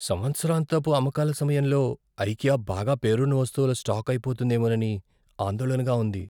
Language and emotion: Telugu, fearful